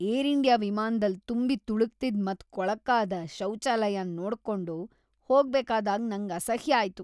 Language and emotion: Kannada, disgusted